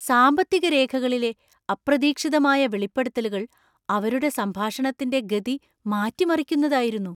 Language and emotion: Malayalam, surprised